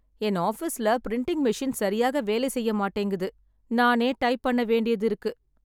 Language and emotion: Tamil, sad